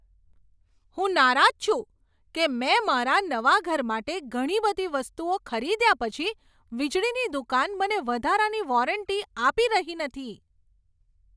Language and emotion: Gujarati, angry